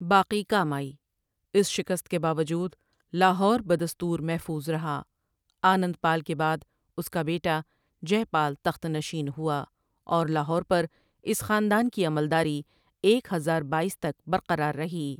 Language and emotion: Urdu, neutral